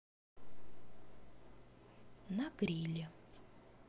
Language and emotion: Russian, neutral